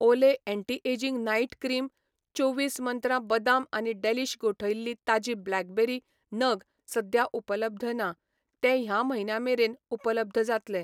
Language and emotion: Goan Konkani, neutral